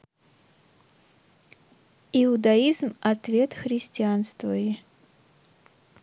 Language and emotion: Russian, neutral